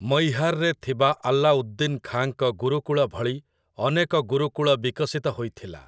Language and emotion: Odia, neutral